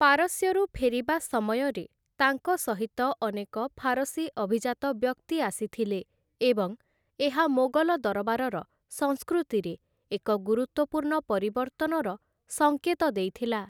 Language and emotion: Odia, neutral